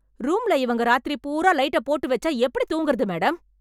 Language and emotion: Tamil, angry